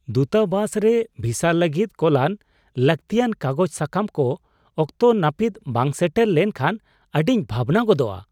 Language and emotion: Santali, surprised